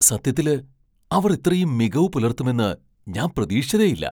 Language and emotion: Malayalam, surprised